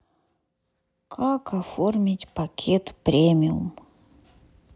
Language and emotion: Russian, sad